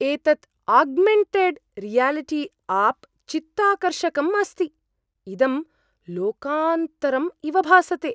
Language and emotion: Sanskrit, surprised